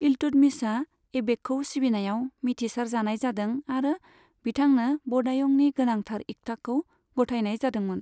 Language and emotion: Bodo, neutral